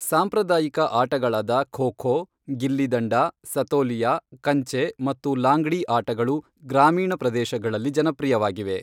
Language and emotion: Kannada, neutral